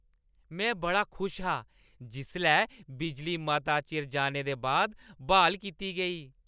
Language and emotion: Dogri, happy